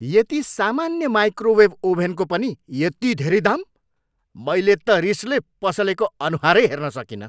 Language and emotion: Nepali, angry